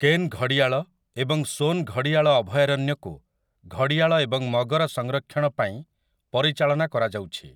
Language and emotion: Odia, neutral